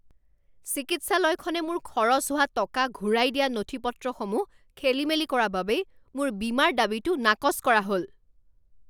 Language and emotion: Assamese, angry